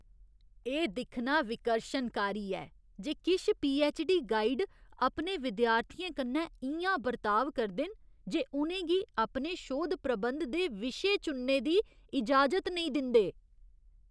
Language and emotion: Dogri, disgusted